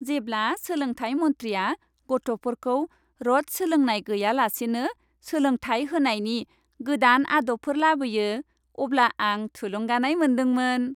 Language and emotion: Bodo, happy